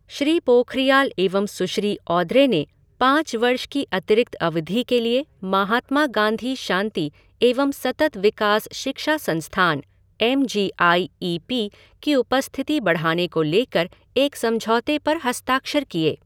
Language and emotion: Hindi, neutral